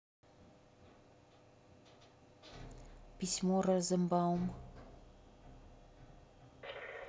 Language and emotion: Russian, neutral